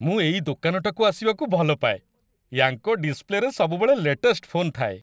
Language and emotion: Odia, happy